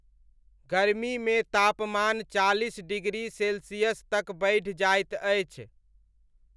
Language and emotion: Maithili, neutral